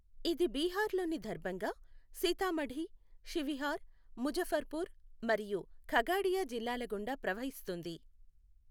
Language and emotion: Telugu, neutral